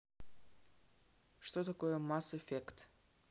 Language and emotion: Russian, neutral